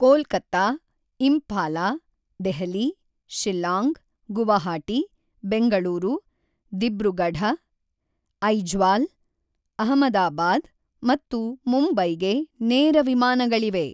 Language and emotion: Kannada, neutral